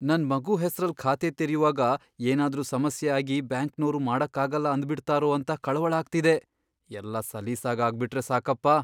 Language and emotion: Kannada, fearful